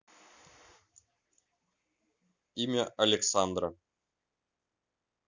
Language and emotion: Russian, neutral